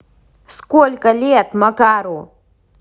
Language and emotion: Russian, angry